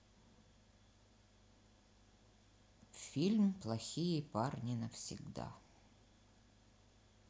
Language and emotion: Russian, sad